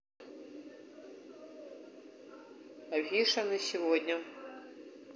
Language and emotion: Russian, neutral